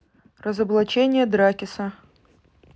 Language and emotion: Russian, neutral